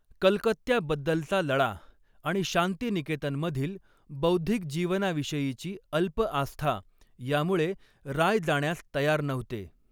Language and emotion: Marathi, neutral